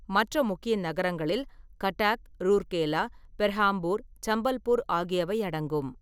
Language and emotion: Tamil, neutral